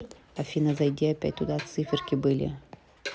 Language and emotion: Russian, neutral